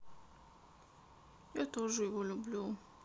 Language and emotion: Russian, sad